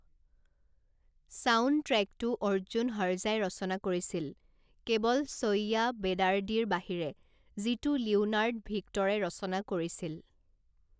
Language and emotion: Assamese, neutral